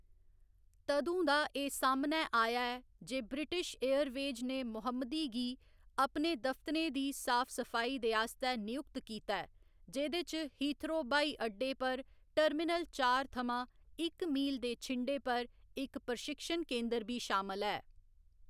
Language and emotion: Dogri, neutral